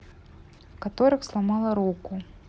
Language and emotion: Russian, neutral